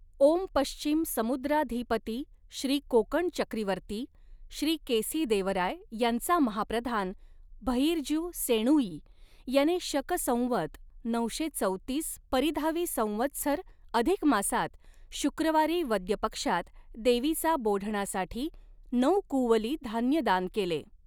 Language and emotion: Marathi, neutral